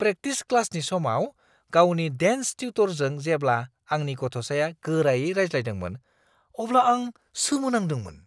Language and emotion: Bodo, surprised